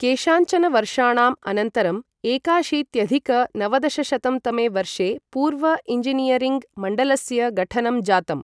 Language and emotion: Sanskrit, neutral